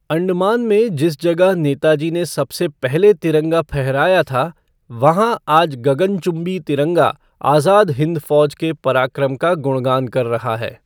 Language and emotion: Hindi, neutral